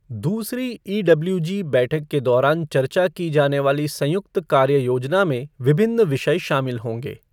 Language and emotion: Hindi, neutral